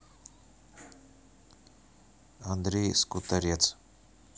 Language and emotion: Russian, neutral